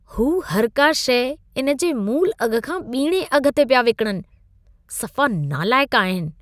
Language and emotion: Sindhi, disgusted